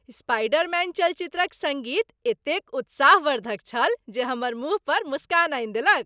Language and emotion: Maithili, happy